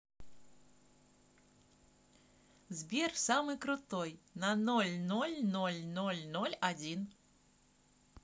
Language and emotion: Russian, positive